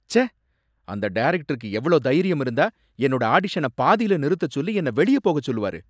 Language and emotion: Tamil, angry